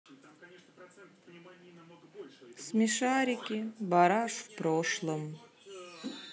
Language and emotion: Russian, sad